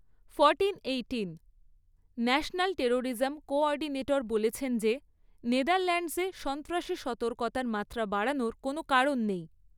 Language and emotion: Bengali, neutral